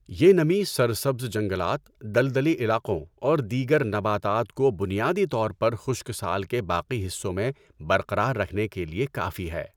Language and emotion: Urdu, neutral